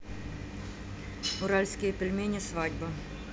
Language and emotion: Russian, neutral